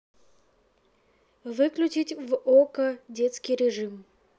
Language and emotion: Russian, neutral